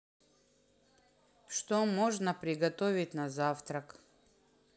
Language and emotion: Russian, neutral